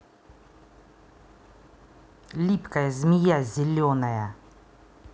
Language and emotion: Russian, angry